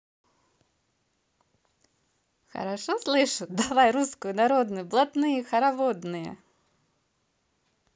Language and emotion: Russian, positive